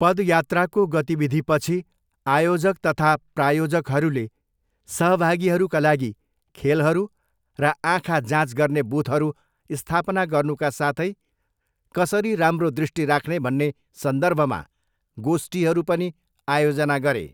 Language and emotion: Nepali, neutral